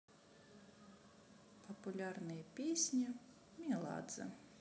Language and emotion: Russian, neutral